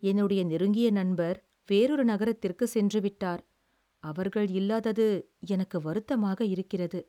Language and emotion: Tamil, sad